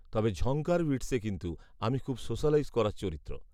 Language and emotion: Bengali, neutral